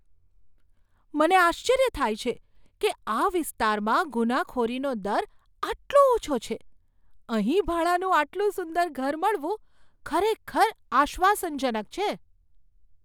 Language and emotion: Gujarati, surprised